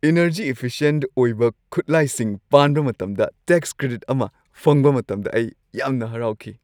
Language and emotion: Manipuri, happy